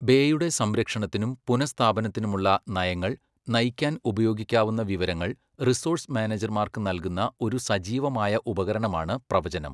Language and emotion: Malayalam, neutral